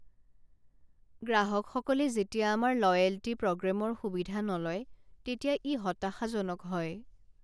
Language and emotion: Assamese, sad